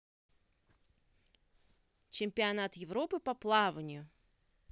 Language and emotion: Russian, neutral